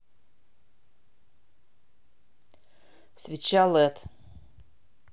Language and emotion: Russian, neutral